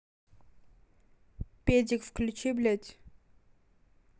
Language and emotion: Russian, angry